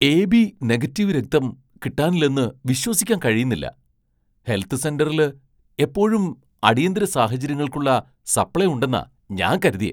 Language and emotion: Malayalam, surprised